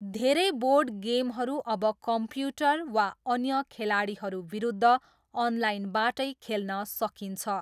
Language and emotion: Nepali, neutral